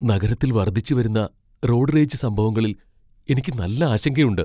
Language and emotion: Malayalam, fearful